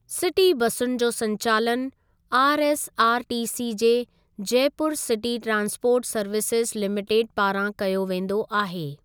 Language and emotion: Sindhi, neutral